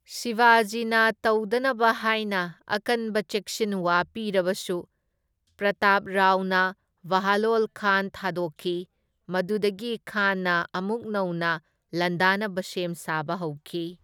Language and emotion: Manipuri, neutral